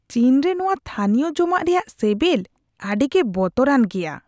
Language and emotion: Santali, disgusted